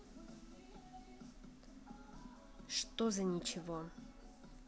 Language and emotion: Russian, neutral